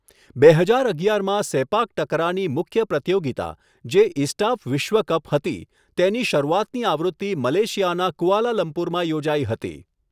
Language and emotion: Gujarati, neutral